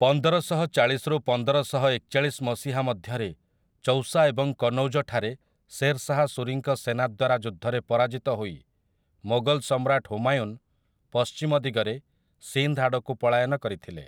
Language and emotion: Odia, neutral